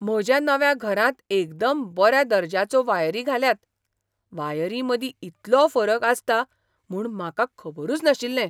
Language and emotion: Goan Konkani, surprised